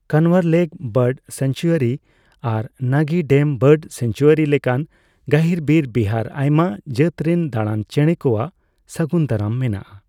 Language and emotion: Santali, neutral